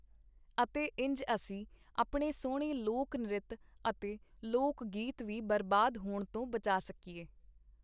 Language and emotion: Punjabi, neutral